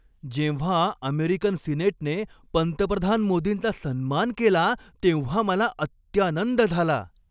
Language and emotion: Marathi, happy